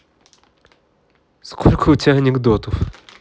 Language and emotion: Russian, positive